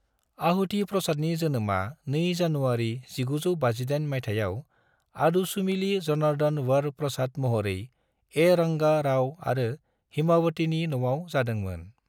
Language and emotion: Bodo, neutral